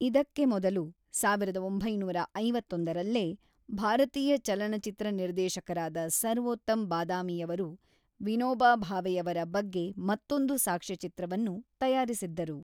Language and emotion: Kannada, neutral